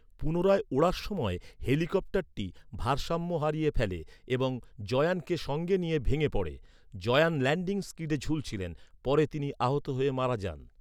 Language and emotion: Bengali, neutral